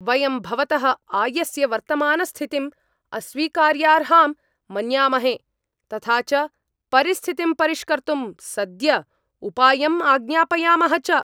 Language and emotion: Sanskrit, angry